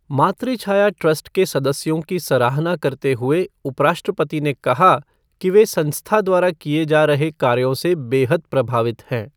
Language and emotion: Hindi, neutral